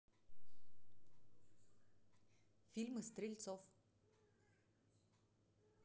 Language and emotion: Russian, neutral